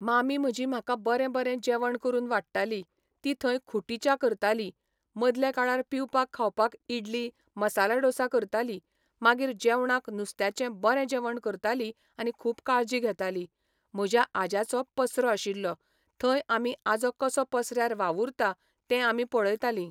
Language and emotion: Goan Konkani, neutral